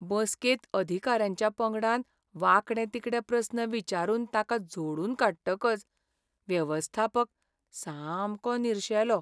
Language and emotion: Goan Konkani, sad